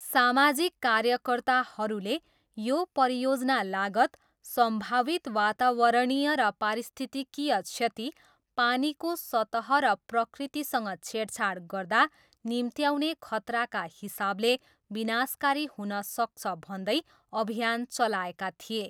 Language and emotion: Nepali, neutral